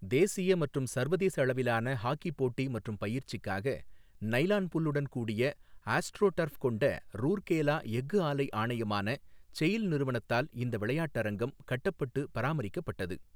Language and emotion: Tamil, neutral